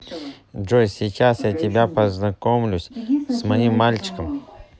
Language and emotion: Russian, neutral